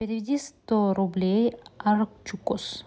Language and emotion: Russian, neutral